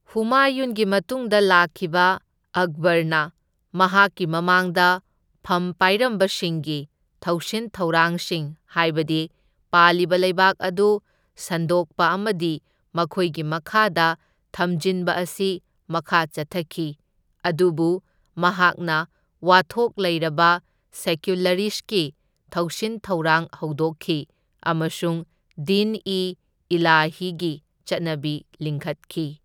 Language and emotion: Manipuri, neutral